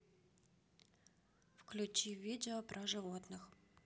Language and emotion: Russian, neutral